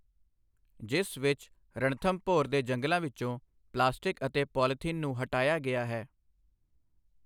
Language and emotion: Punjabi, neutral